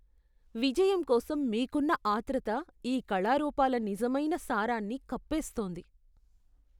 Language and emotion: Telugu, disgusted